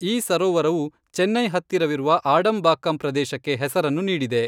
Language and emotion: Kannada, neutral